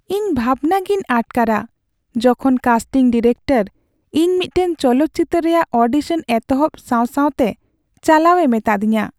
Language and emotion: Santali, sad